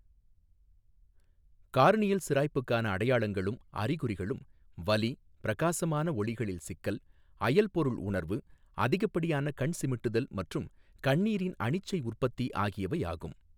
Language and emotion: Tamil, neutral